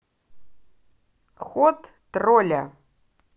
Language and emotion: Russian, positive